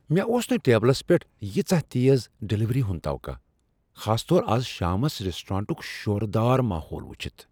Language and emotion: Kashmiri, surprised